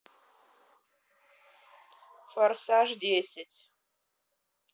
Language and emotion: Russian, neutral